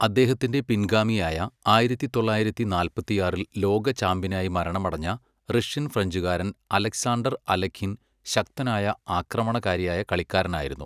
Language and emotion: Malayalam, neutral